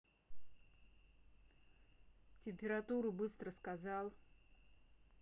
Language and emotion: Russian, angry